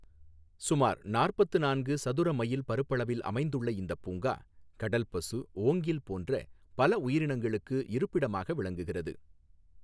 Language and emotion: Tamil, neutral